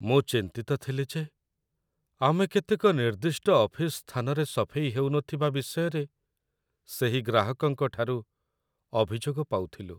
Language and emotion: Odia, sad